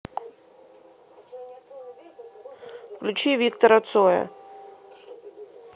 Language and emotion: Russian, neutral